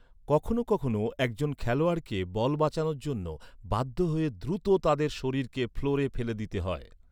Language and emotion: Bengali, neutral